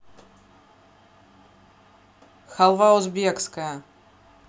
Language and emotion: Russian, neutral